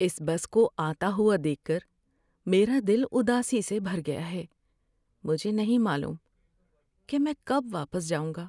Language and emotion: Urdu, sad